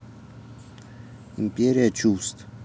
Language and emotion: Russian, neutral